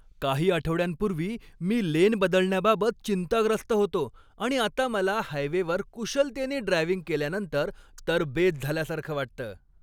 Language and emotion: Marathi, happy